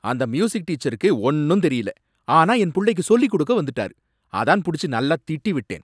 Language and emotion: Tamil, angry